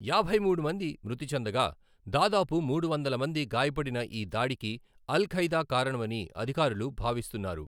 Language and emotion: Telugu, neutral